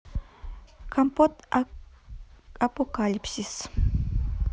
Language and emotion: Russian, neutral